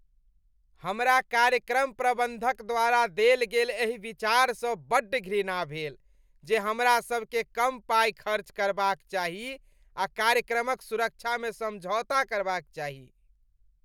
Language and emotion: Maithili, disgusted